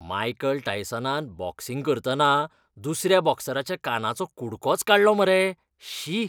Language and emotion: Goan Konkani, disgusted